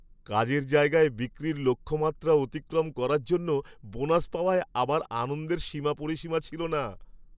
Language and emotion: Bengali, happy